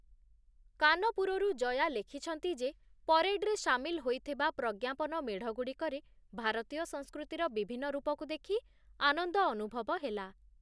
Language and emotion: Odia, neutral